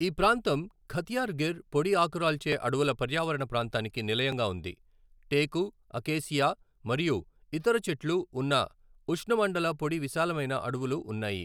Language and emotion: Telugu, neutral